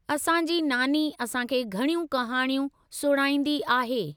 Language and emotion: Sindhi, neutral